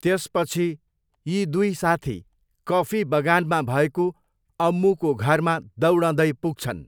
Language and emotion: Nepali, neutral